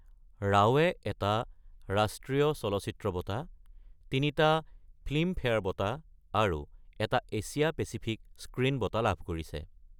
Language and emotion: Assamese, neutral